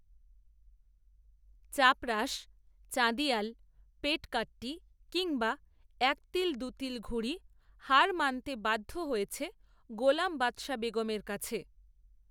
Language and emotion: Bengali, neutral